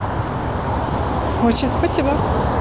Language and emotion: Russian, positive